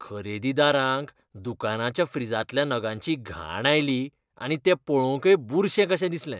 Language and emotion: Goan Konkani, disgusted